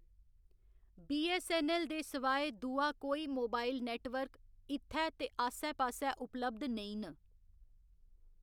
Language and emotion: Dogri, neutral